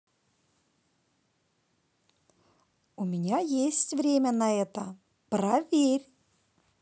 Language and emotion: Russian, positive